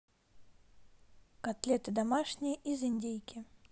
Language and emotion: Russian, neutral